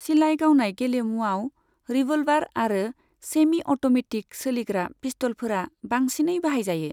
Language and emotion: Bodo, neutral